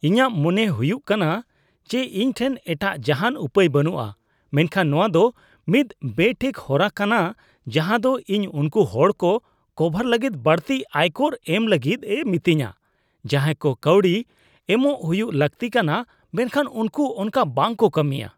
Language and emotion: Santali, disgusted